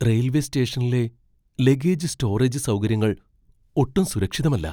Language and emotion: Malayalam, fearful